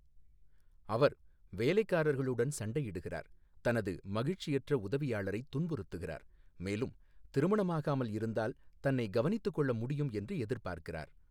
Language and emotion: Tamil, neutral